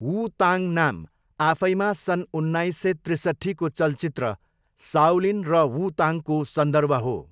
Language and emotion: Nepali, neutral